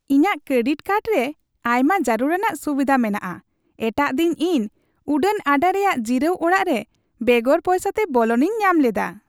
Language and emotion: Santali, happy